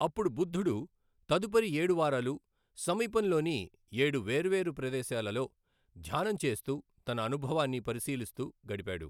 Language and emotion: Telugu, neutral